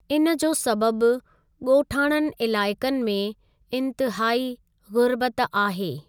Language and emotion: Sindhi, neutral